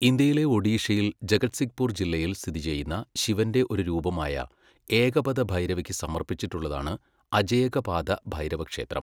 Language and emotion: Malayalam, neutral